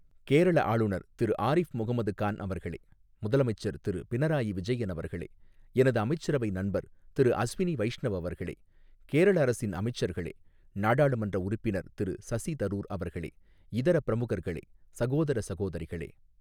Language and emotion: Tamil, neutral